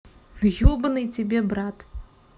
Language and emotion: Russian, neutral